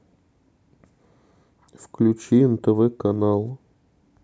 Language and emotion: Russian, sad